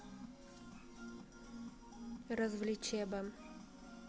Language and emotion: Russian, neutral